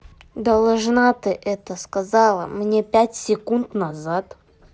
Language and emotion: Russian, angry